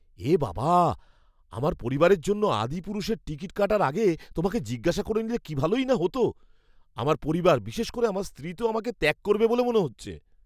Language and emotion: Bengali, fearful